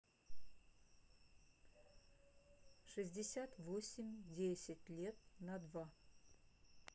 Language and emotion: Russian, neutral